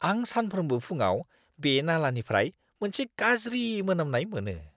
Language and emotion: Bodo, disgusted